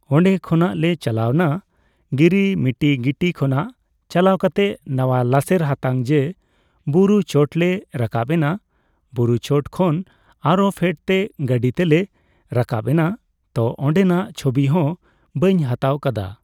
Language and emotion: Santali, neutral